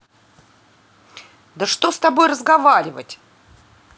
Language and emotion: Russian, angry